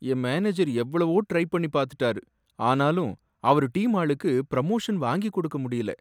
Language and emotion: Tamil, sad